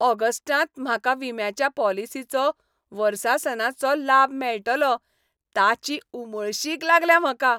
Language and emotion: Goan Konkani, happy